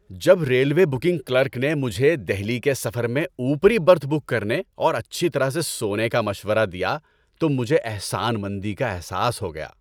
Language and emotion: Urdu, happy